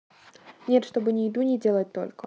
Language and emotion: Russian, neutral